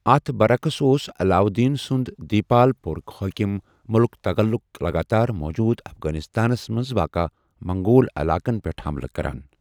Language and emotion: Kashmiri, neutral